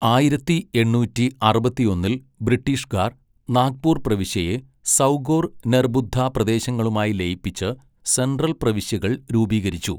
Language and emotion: Malayalam, neutral